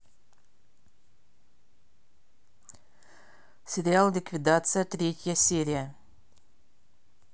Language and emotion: Russian, neutral